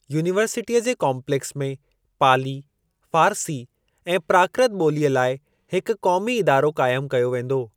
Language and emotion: Sindhi, neutral